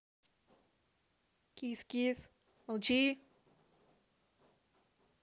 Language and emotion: Russian, neutral